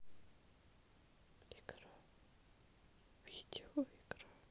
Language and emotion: Russian, sad